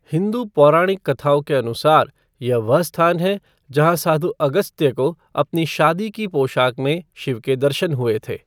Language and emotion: Hindi, neutral